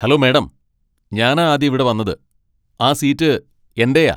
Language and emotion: Malayalam, angry